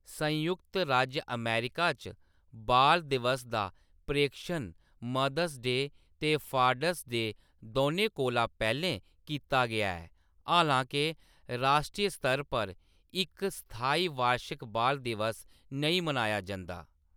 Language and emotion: Dogri, neutral